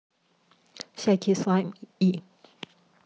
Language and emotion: Russian, neutral